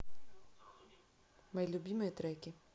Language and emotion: Russian, neutral